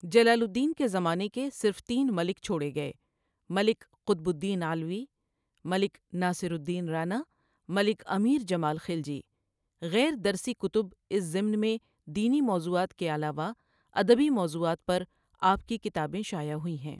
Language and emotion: Urdu, neutral